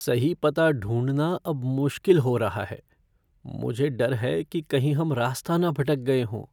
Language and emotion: Hindi, fearful